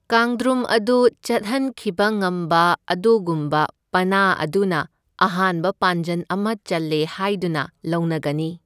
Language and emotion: Manipuri, neutral